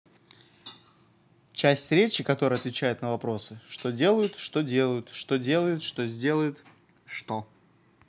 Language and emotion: Russian, neutral